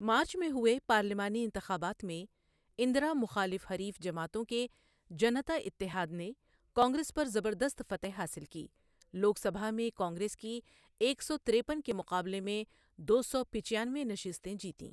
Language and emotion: Urdu, neutral